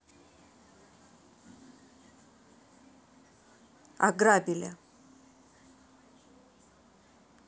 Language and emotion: Russian, neutral